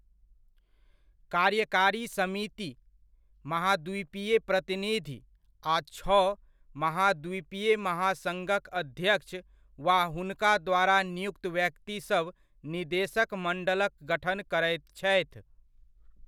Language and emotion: Maithili, neutral